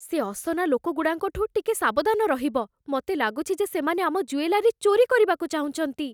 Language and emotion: Odia, fearful